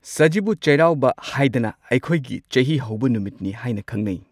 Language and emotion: Manipuri, neutral